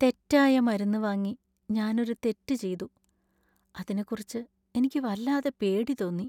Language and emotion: Malayalam, sad